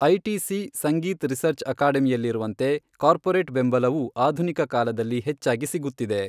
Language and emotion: Kannada, neutral